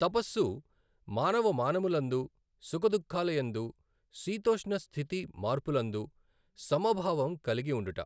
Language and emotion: Telugu, neutral